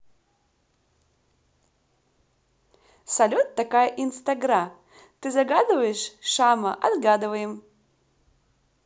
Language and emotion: Russian, positive